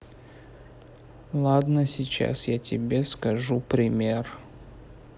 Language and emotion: Russian, neutral